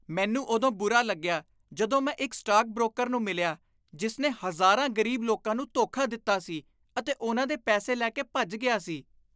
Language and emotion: Punjabi, disgusted